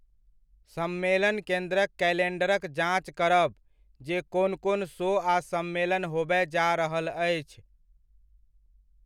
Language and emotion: Maithili, neutral